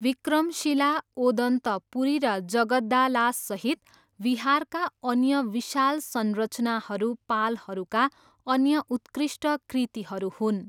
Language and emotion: Nepali, neutral